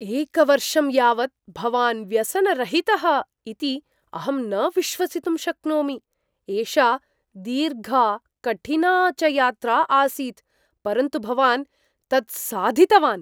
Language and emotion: Sanskrit, surprised